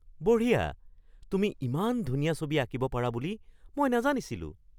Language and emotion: Assamese, surprised